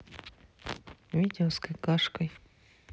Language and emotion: Russian, neutral